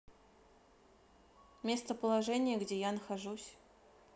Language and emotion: Russian, neutral